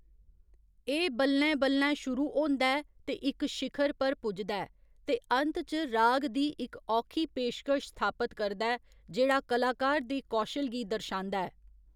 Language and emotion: Dogri, neutral